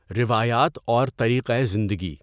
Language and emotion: Urdu, neutral